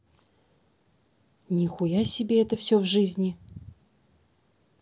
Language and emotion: Russian, neutral